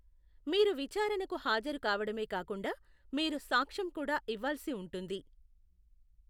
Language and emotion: Telugu, neutral